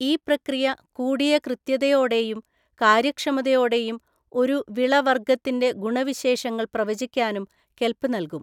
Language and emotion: Malayalam, neutral